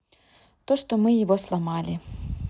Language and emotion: Russian, neutral